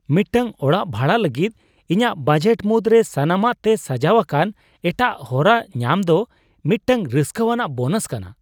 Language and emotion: Santali, surprised